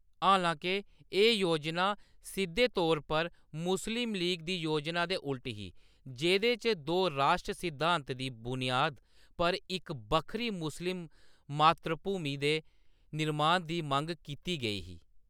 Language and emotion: Dogri, neutral